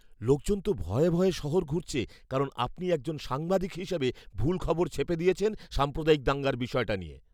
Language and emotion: Bengali, fearful